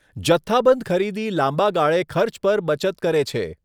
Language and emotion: Gujarati, neutral